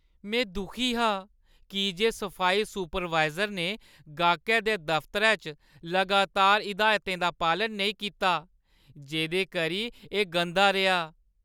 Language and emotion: Dogri, sad